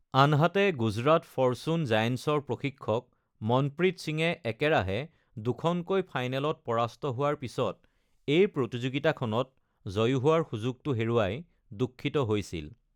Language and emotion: Assamese, neutral